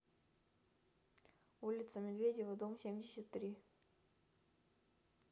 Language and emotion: Russian, neutral